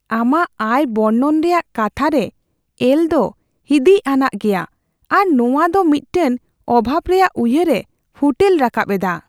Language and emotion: Santali, fearful